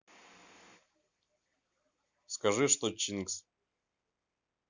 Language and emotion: Russian, neutral